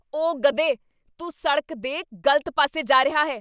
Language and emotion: Punjabi, angry